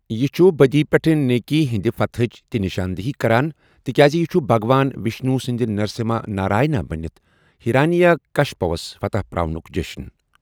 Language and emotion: Kashmiri, neutral